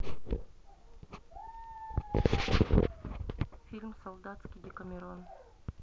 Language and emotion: Russian, neutral